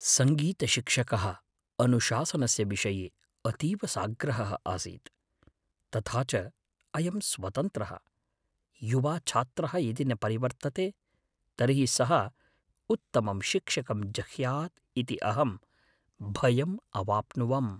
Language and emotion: Sanskrit, fearful